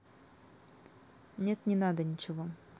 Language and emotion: Russian, neutral